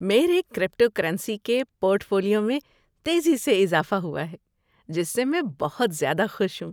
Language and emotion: Urdu, happy